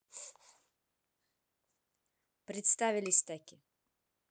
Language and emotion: Russian, neutral